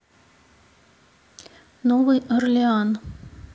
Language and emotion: Russian, neutral